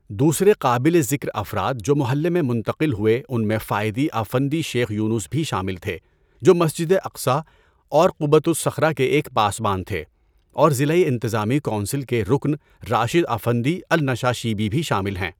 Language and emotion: Urdu, neutral